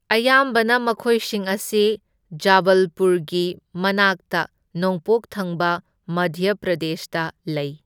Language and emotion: Manipuri, neutral